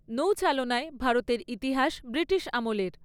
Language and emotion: Bengali, neutral